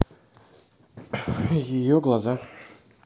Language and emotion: Russian, neutral